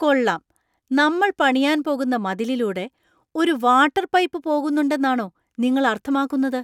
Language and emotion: Malayalam, surprised